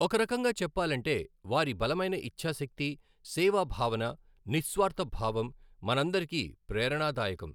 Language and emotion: Telugu, neutral